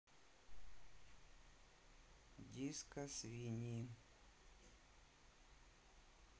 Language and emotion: Russian, neutral